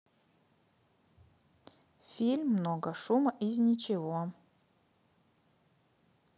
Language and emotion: Russian, neutral